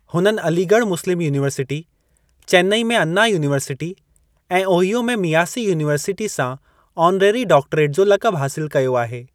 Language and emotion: Sindhi, neutral